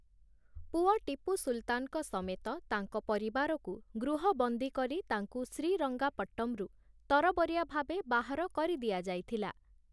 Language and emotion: Odia, neutral